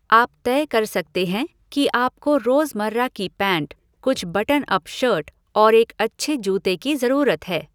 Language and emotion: Hindi, neutral